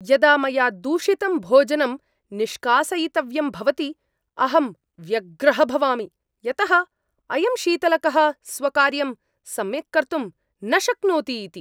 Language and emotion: Sanskrit, angry